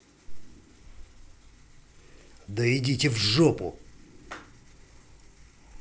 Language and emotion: Russian, angry